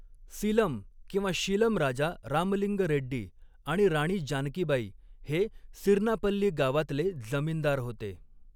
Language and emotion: Marathi, neutral